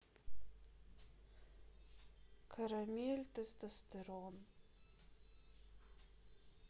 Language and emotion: Russian, sad